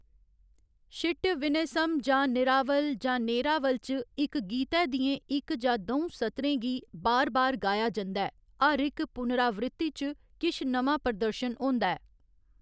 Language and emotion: Dogri, neutral